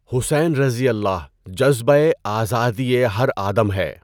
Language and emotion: Urdu, neutral